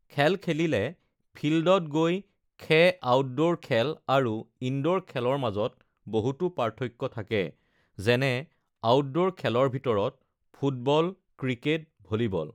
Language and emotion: Assamese, neutral